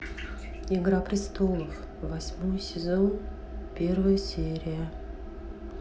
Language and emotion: Russian, neutral